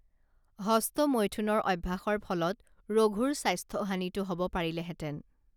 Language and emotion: Assamese, neutral